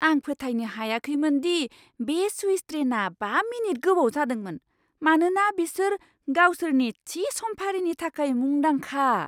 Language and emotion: Bodo, surprised